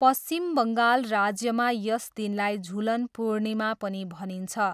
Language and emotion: Nepali, neutral